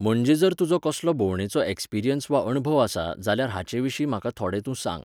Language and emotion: Goan Konkani, neutral